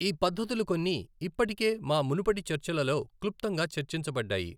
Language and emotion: Telugu, neutral